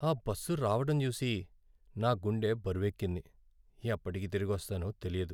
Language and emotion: Telugu, sad